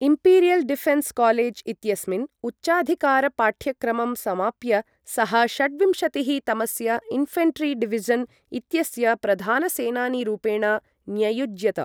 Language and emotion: Sanskrit, neutral